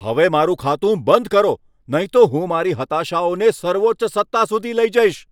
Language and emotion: Gujarati, angry